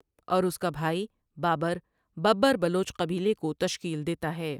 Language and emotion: Urdu, neutral